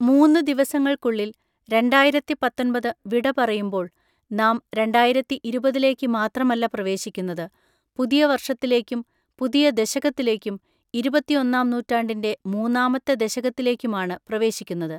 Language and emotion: Malayalam, neutral